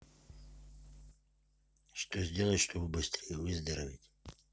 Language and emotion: Russian, neutral